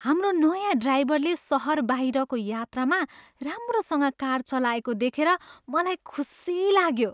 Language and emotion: Nepali, happy